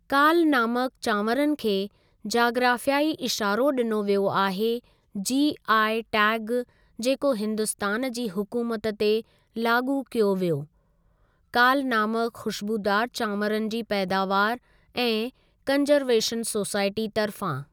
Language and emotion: Sindhi, neutral